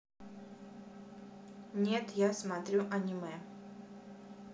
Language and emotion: Russian, neutral